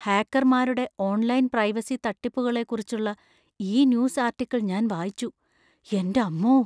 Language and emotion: Malayalam, fearful